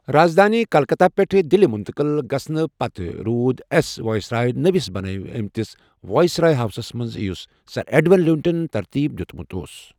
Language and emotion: Kashmiri, neutral